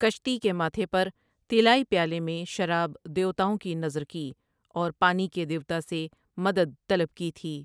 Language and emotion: Urdu, neutral